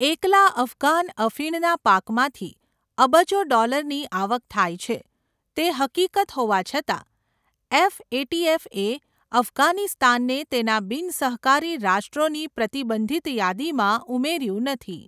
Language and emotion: Gujarati, neutral